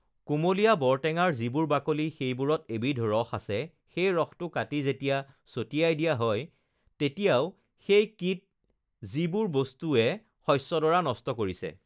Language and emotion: Assamese, neutral